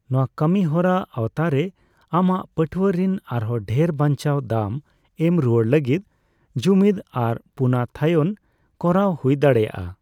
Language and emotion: Santali, neutral